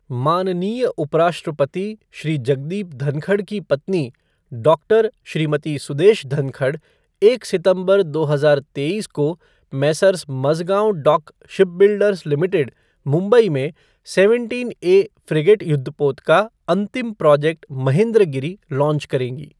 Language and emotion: Hindi, neutral